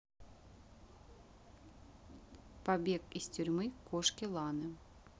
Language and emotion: Russian, neutral